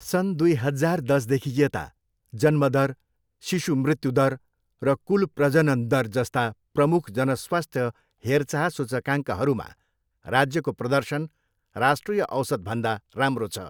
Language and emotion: Nepali, neutral